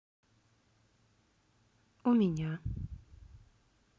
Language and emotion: Russian, neutral